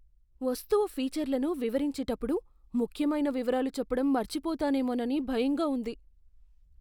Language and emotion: Telugu, fearful